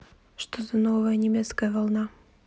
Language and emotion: Russian, neutral